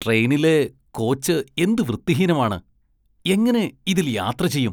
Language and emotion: Malayalam, disgusted